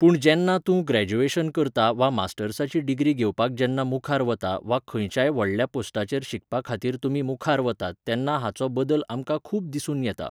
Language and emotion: Goan Konkani, neutral